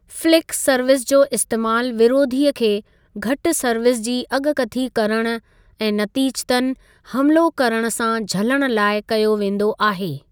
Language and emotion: Sindhi, neutral